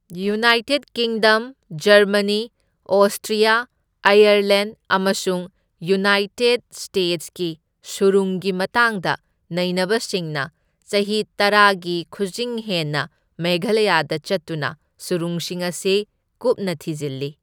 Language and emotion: Manipuri, neutral